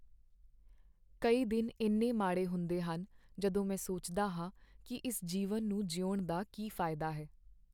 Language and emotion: Punjabi, sad